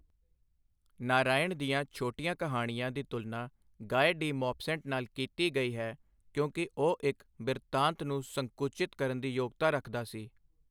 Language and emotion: Punjabi, neutral